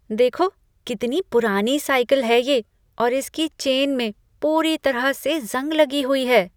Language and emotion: Hindi, disgusted